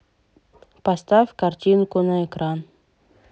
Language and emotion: Russian, neutral